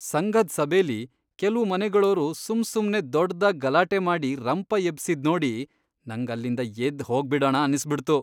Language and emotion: Kannada, disgusted